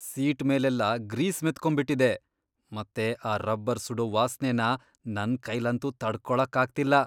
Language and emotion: Kannada, disgusted